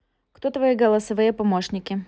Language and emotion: Russian, neutral